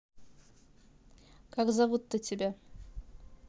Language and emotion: Russian, neutral